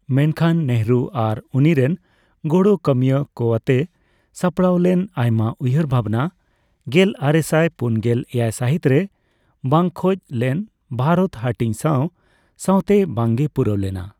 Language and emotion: Santali, neutral